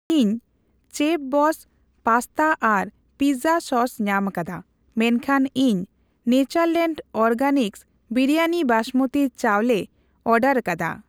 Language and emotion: Santali, neutral